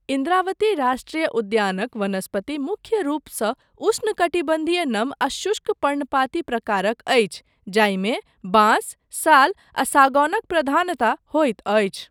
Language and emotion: Maithili, neutral